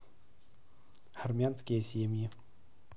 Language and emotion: Russian, neutral